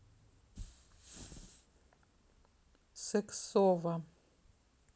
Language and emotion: Russian, neutral